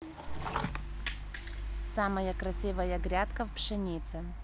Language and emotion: Russian, neutral